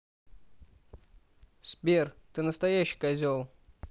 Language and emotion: Russian, neutral